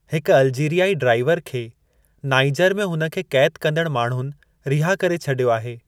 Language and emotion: Sindhi, neutral